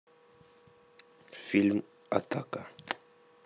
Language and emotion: Russian, neutral